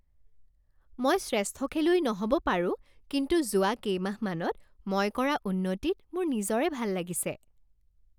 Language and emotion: Assamese, happy